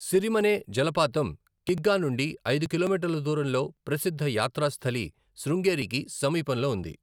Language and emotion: Telugu, neutral